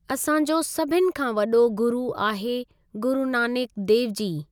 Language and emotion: Sindhi, neutral